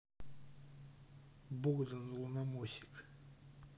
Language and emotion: Russian, neutral